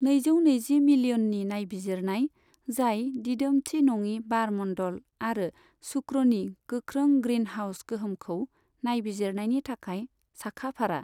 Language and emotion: Bodo, neutral